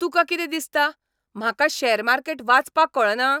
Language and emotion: Goan Konkani, angry